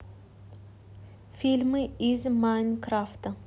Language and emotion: Russian, neutral